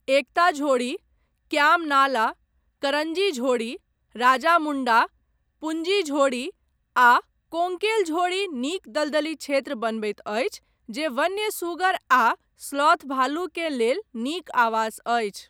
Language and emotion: Maithili, neutral